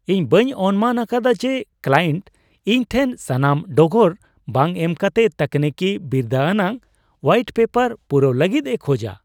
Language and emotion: Santali, surprised